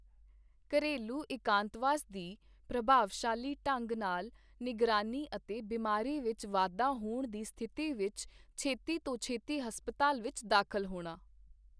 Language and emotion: Punjabi, neutral